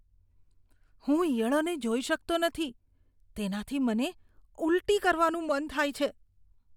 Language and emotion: Gujarati, disgusted